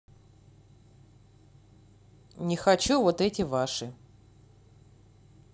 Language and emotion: Russian, angry